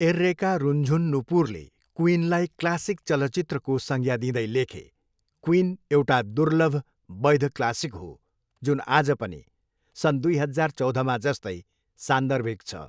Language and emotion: Nepali, neutral